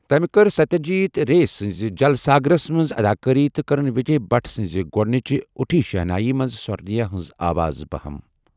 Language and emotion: Kashmiri, neutral